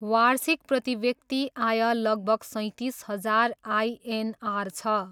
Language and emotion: Nepali, neutral